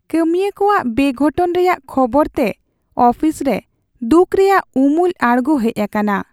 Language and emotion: Santali, sad